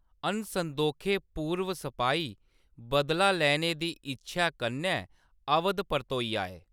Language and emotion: Dogri, neutral